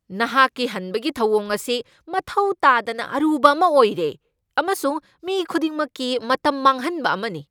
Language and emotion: Manipuri, angry